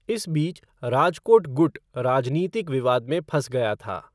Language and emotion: Hindi, neutral